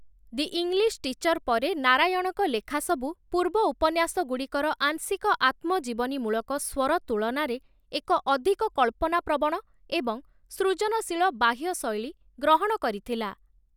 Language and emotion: Odia, neutral